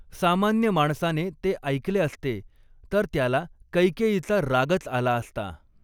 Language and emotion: Marathi, neutral